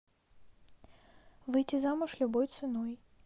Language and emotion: Russian, neutral